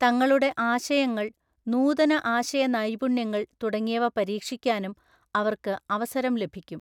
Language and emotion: Malayalam, neutral